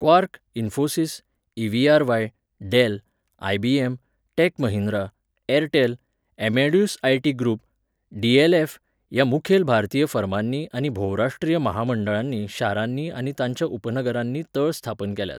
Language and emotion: Goan Konkani, neutral